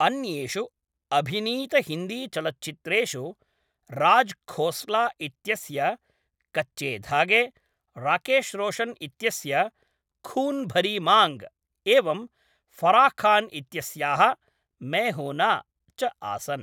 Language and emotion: Sanskrit, neutral